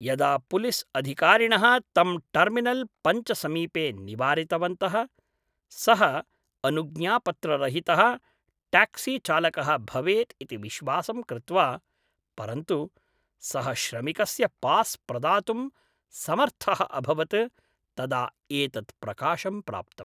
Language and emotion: Sanskrit, neutral